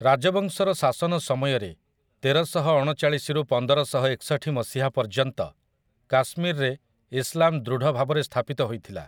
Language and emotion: Odia, neutral